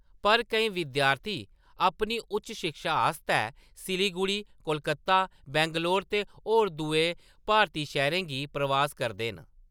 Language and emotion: Dogri, neutral